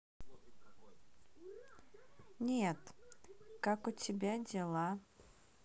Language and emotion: Russian, neutral